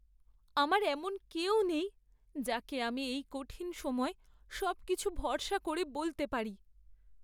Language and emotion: Bengali, sad